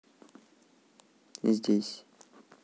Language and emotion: Russian, neutral